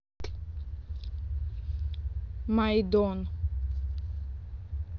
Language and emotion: Russian, neutral